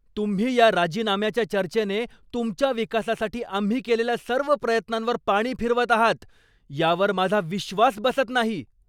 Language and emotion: Marathi, angry